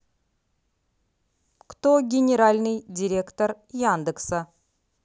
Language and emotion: Russian, neutral